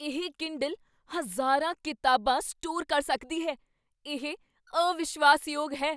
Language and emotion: Punjabi, surprised